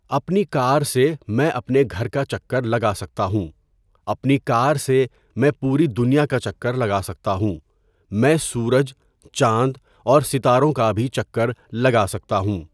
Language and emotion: Urdu, neutral